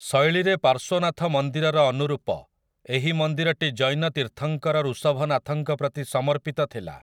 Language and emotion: Odia, neutral